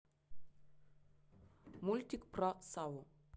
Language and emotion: Russian, neutral